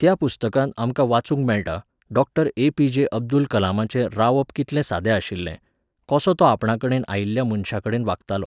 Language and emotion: Goan Konkani, neutral